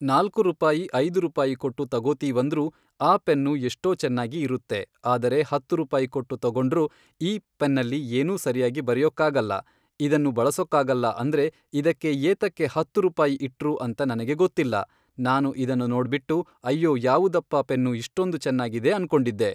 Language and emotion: Kannada, neutral